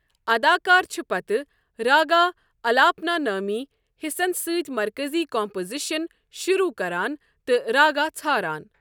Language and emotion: Kashmiri, neutral